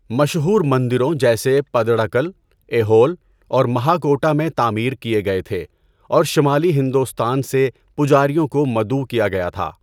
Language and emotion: Urdu, neutral